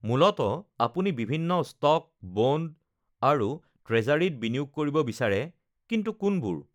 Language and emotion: Assamese, neutral